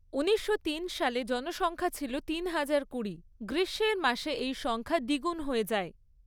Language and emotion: Bengali, neutral